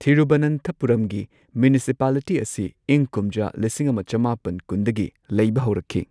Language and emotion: Manipuri, neutral